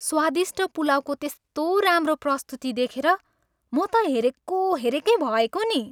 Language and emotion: Nepali, happy